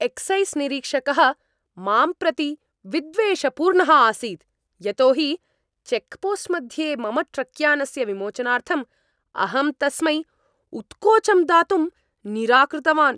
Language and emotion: Sanskrit, angry